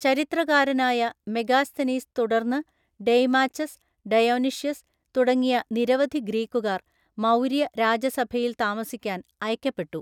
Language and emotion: Malayalam, neutral